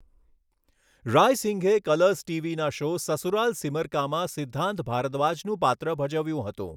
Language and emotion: Gujarati, neutral